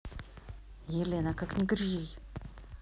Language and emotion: Russian, angry